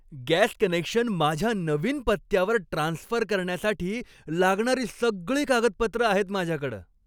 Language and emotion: Marathi, happy